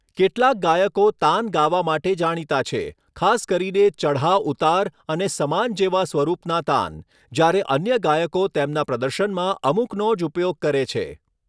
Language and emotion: Gujarati, neutral